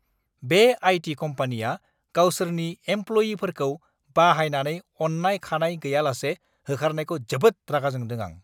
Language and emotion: Bodo, angry